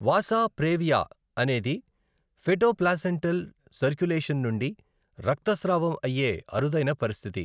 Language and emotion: Telugu, neutral